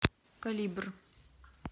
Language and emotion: Russian, neutral